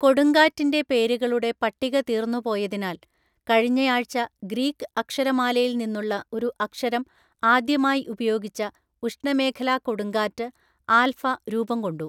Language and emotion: Malayalam, neutral